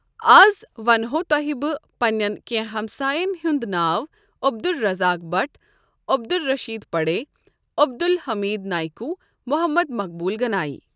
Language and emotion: Kashmiri, neutral